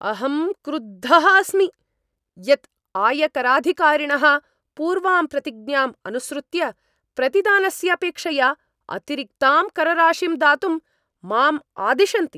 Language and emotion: Sanskrit, angry